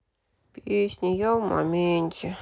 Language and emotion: Russian, sad